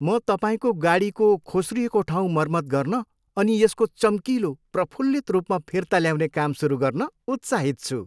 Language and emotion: Nepali, happy